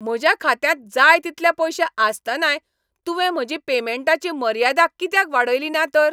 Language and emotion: Goan Konkani, angry